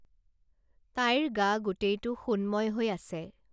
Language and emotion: Assamese, neutral